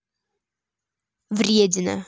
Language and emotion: Russian, angry